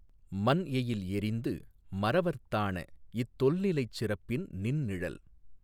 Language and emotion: Tamil, neutral